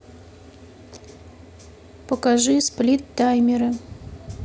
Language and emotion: Russian, neutral